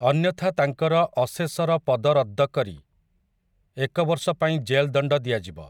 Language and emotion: Odia, neutral